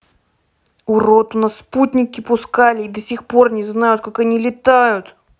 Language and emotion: Russian, angry